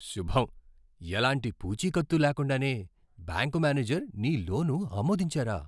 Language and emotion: Telugu, surprised